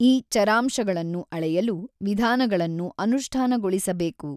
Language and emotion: Kannada, neutral